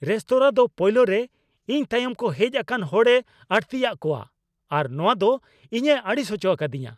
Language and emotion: Santali, angry